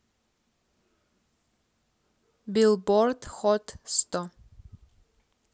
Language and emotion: Russian, neutral